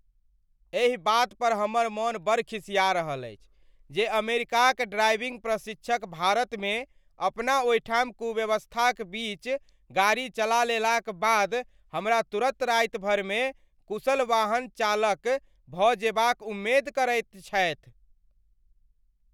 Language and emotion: Maithili, angry